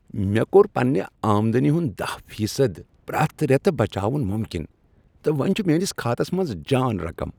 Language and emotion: Kashmiri, happy